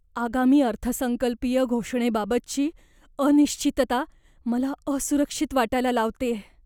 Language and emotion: Marathi, fearful